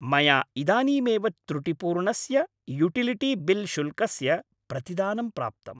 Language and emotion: Sanskrit, happy